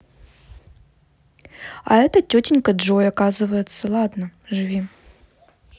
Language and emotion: Russian, neutral